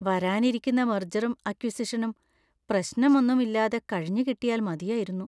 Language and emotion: Malayalam, fearful